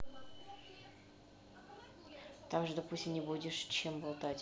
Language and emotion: Russian, neutral